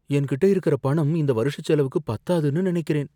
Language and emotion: Tamil, fearful